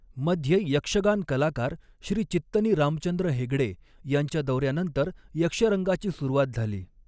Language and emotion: Marathi, neutral